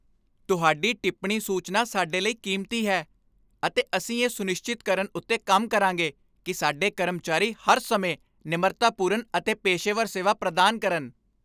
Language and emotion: Punjabi, happy